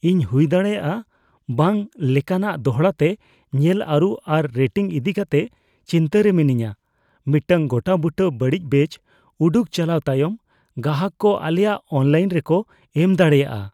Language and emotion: Santali, fearful